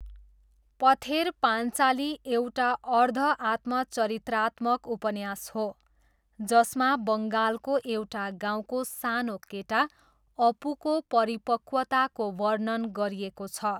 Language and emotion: Nepali, neutral